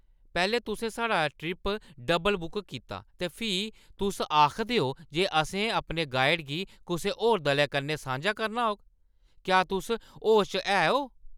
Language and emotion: Dogri, angry